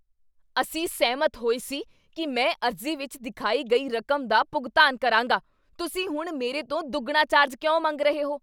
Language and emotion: Punjabi, angry